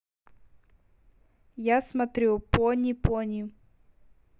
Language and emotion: Russian, neutral